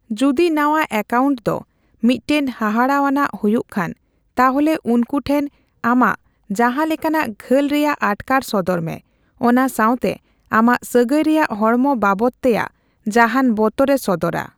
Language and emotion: Santali, neutral